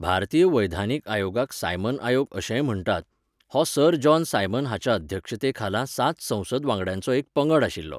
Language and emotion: Goan Konkani, neutral